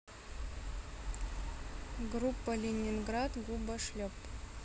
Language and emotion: Russian, neutral